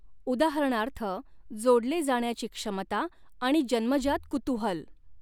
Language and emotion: Marathi, neutral